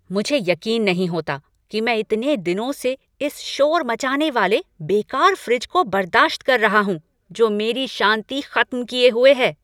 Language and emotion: Hindi, angry